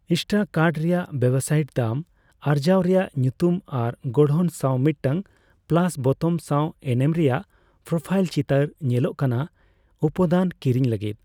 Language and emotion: Santali, neutral